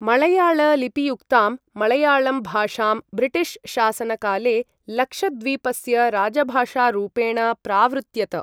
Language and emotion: Sanskrit, neutral